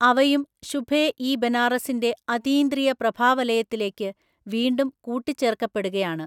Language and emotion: Malayalam, neutral